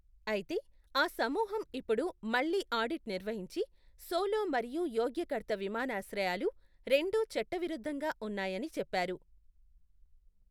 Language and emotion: Telugu, neutral